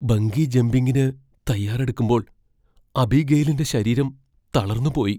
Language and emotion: Malayalam, fearful